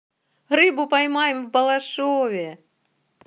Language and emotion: Russian, positive